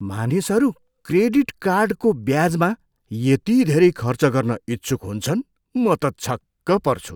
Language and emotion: Nepali, surprised